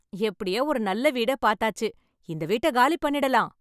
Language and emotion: Tamil, happy